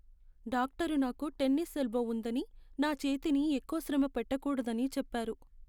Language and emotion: Telugu, sad